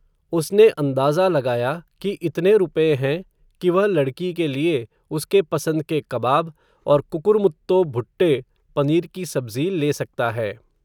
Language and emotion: Hindi, neutral